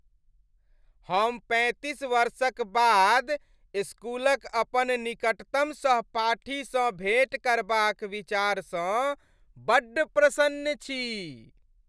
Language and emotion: Maithili, happy